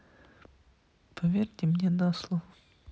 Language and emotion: Russian, sad